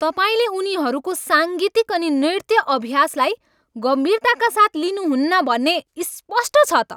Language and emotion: Nepali, angry